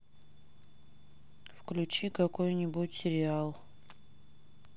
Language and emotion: Russian, sad